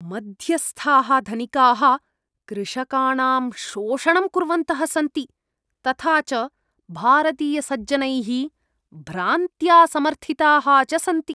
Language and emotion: Sanskrit, disgusted